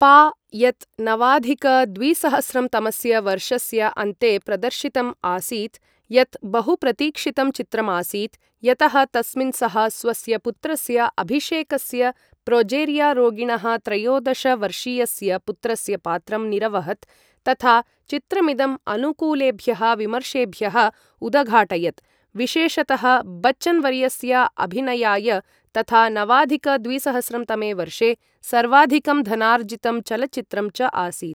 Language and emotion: Sanskrit, neutral